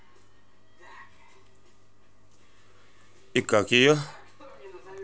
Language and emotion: Russian, neutral